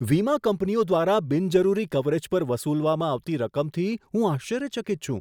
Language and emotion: Gujarati, surprised